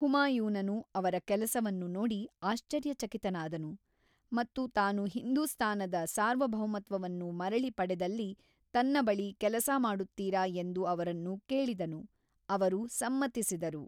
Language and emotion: Kannada, neutral